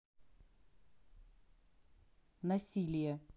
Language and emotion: Russian, neutral